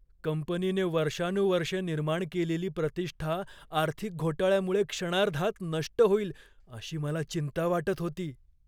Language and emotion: Marathi, fearful